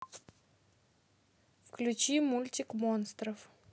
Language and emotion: Russian, neutral